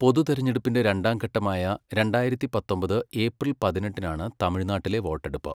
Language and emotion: Malayalam, neutral